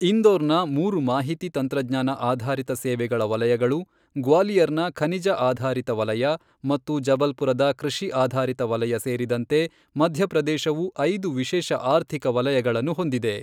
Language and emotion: Kannada, neutral